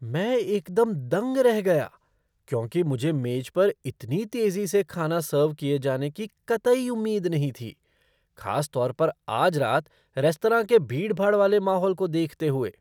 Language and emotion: Hindi, surprised